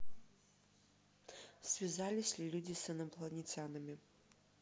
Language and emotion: Russian, neutral